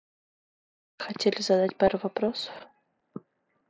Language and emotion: Russian, neutral